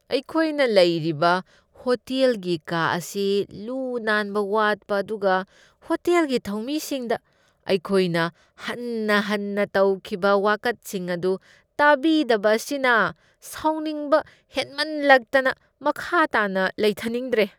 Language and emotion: Manipuri, disgusted